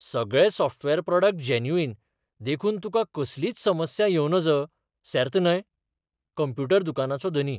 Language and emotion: Goan Konkani, surprised